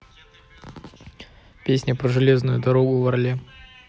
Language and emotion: Russian, neutral